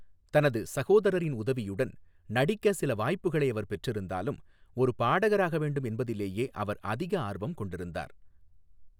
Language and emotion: Tamil, neutral